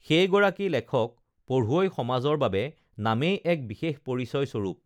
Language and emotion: Assamese, neutral